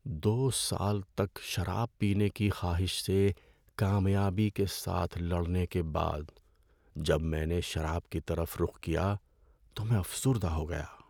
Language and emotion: Urdu, sad